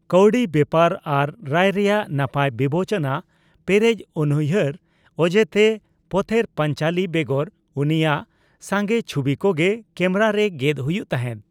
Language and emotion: Santali, neutral